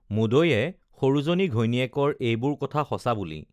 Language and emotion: Assamese, neutral